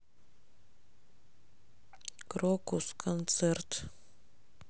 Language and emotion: Russian, neutral